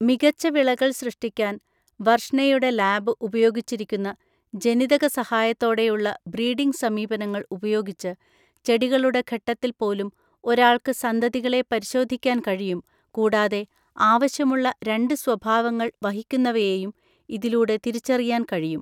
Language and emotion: Malayalam, neutral